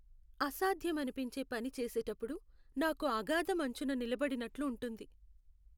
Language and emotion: Telugu, sad